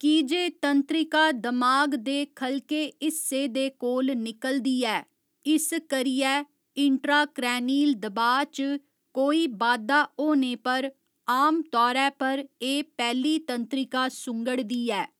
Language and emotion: Dogri, neutral